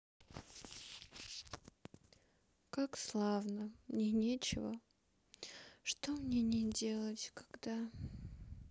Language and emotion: Russian, sad